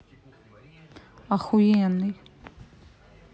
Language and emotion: Russian, neutral